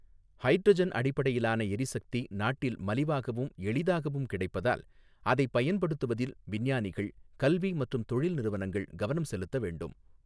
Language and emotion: Tamil, neutral